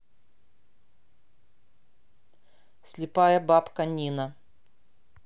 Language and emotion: Russian, neutral